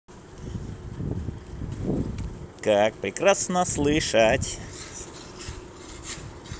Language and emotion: Russian, positive